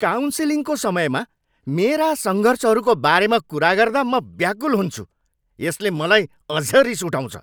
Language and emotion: Nepali, angry